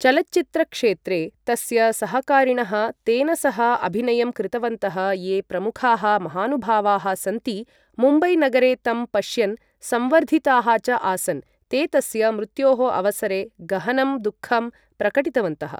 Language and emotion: Sanskrit, neutral